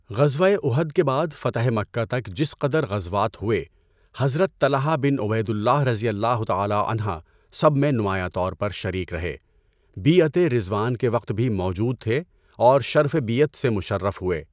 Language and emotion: Urdu, neutral